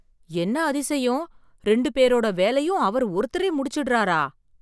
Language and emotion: Tamil, surprised